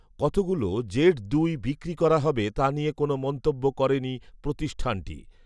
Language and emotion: Bengali, neutral